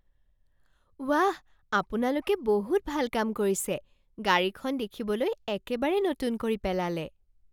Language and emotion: Assamese, surprised